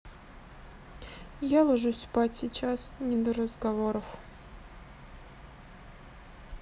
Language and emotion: Russian, sad